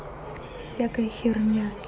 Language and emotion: Russian, angry